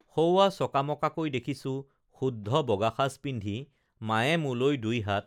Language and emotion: Assamese, neutral